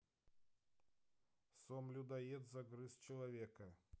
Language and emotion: Russian, neutral